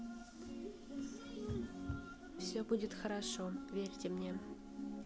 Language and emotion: Russian, neutral